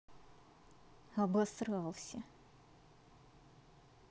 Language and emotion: Russian, angry